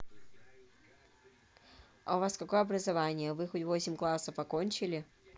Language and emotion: Russian, neutral